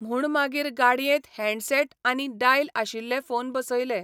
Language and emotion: Goan Konkani, neutral